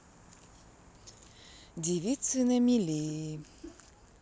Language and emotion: Russian, sad